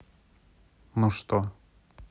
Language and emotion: Russian, neutral